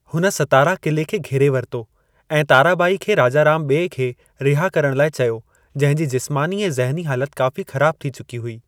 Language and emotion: Sindhi, neutral